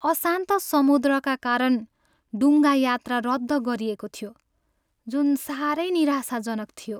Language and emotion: Nepali, sad